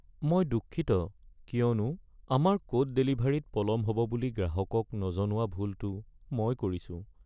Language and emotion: Assamese, sad